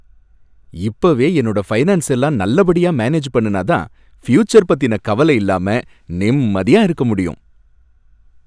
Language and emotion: Tamil, happy